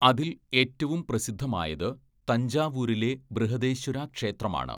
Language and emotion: Malayalam, neutral